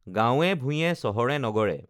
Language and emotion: Assamese, neutral